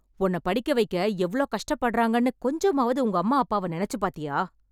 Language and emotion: Tamil, angry